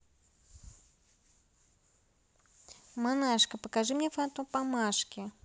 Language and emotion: Russian, neutral